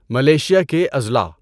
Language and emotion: Urdu, neutral